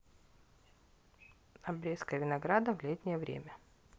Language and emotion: Russian, neutral